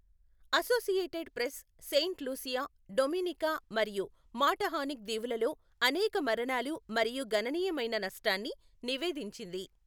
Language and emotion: Telugu, neutral